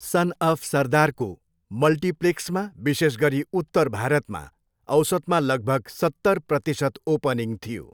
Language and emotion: Nepali, neutral